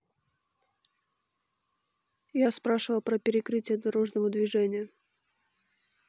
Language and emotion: Russian, neutral